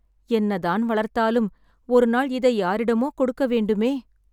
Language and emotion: Tamil, sad